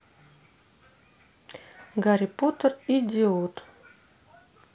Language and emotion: Russian, neutral